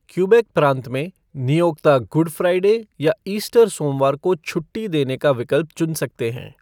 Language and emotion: Hindi, neutral